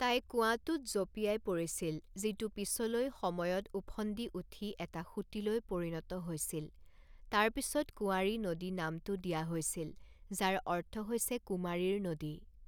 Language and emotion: Assamese, neutral